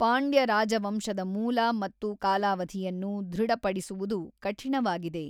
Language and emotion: Kannada, neutral